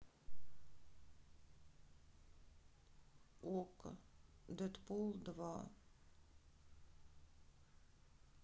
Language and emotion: Russian, sad